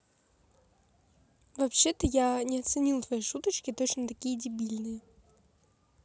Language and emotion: Russian, neutral